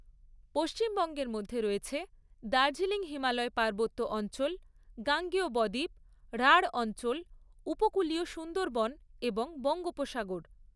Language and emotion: Bengali, neutral